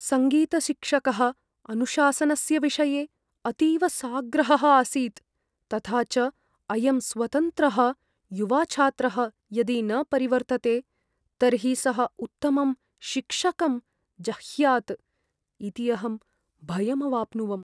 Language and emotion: Sanskrit, fearful